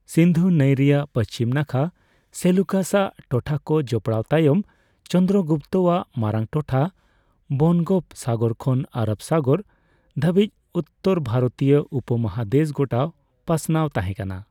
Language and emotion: Santali, neutral